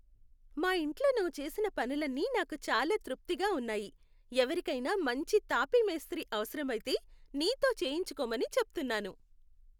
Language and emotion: Telugu, happy